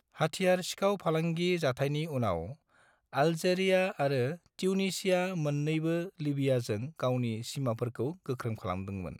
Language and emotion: Bodo, neutral